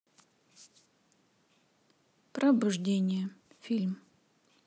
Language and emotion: Russian, neutral